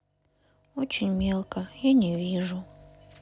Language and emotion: Russian, sad